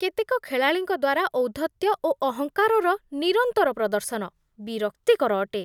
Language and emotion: Odia, disgusted